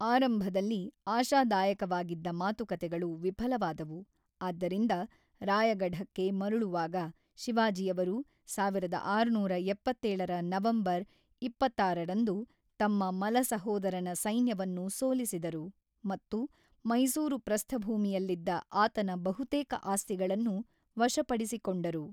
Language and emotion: Kannada, neutral